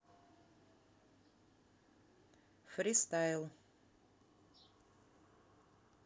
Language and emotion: Russian, neutral